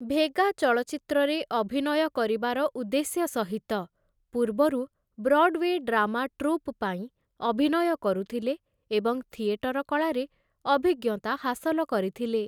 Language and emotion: Odia, neutral